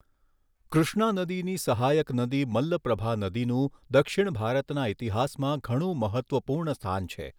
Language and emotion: Gujarati, neutral